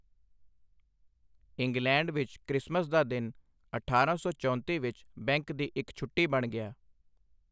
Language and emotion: Punjabi, neutral